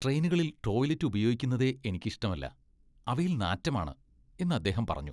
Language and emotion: Malayalam, disgusted